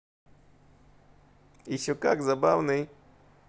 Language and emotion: Russian, positive